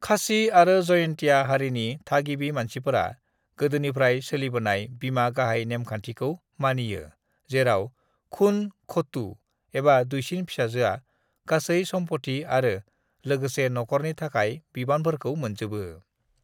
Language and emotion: Bodo, neutral